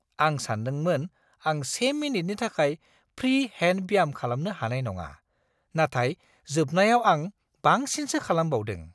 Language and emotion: Bodo, surprised